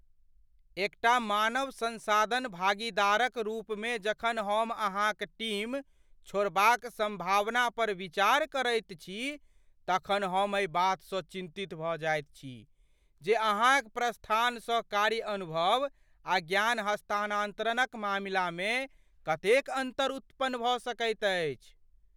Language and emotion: Maithili, fearful